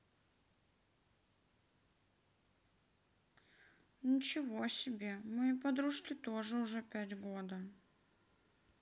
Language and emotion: Russian, sad